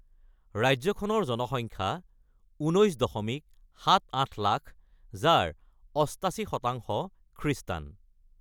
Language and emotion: Assamese, neutral